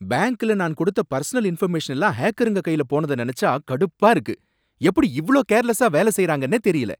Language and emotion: Tamil, angry